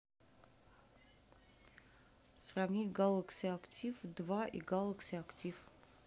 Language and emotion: Russian, neutral